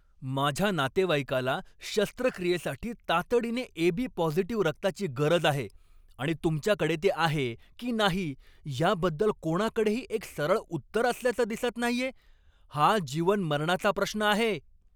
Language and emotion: Marathi, angry